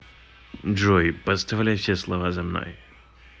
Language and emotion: Russian, neutral